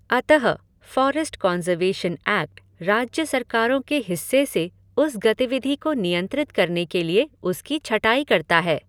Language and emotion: Hindi, neutral